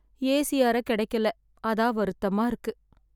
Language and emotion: Tamil, sad